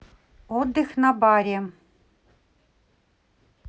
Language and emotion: Russian, neutral